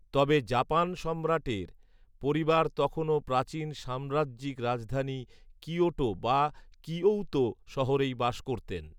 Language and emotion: Bengali, neutral